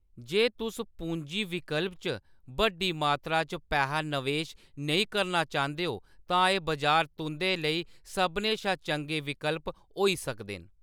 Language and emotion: Dogri, neutral